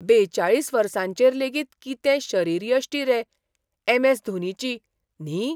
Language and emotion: Goan Konkani, surprised